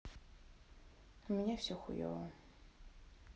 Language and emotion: Russian, sad